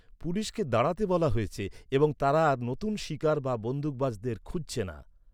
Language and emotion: Bengali, neutral